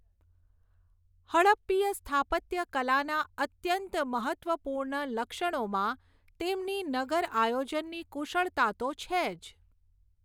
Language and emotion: Gujarati, neutral